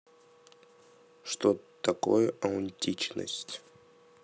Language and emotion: Russian, neutral